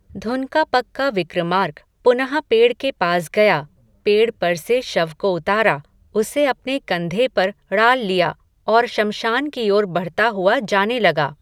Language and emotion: Hindi, neutral